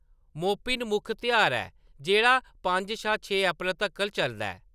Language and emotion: Dogri, neutral